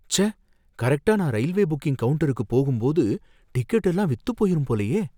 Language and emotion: Tamil, fearful